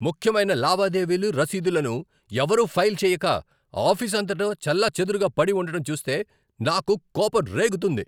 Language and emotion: Telugu, angry